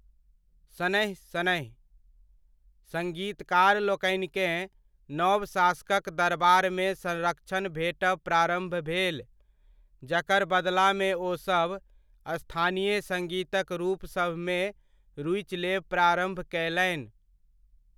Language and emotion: Maithili, neutral